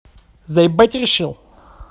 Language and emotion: Russian, angry